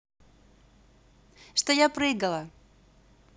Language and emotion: Russian, positive